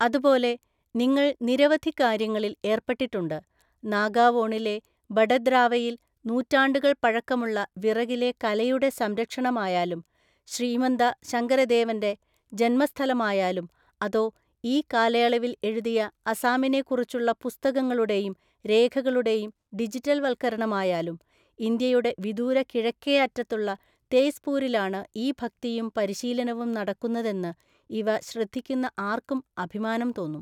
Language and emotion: Malayalam, neutral